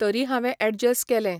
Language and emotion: Goan Konkani, neutral